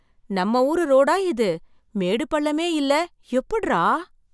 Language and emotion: Tamil, surprised